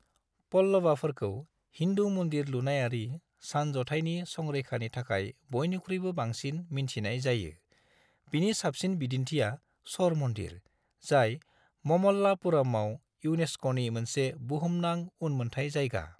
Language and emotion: Bodo, neutral